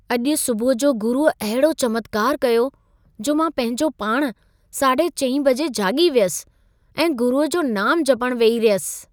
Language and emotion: Sindhi, surprised